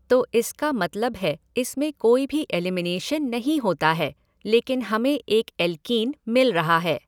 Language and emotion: Hindi, neutral